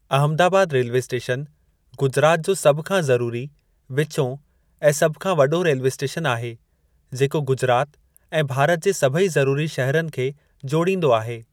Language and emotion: Sindhi, neutral